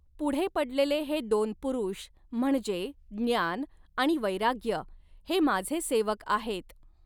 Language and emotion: Marathi, neutral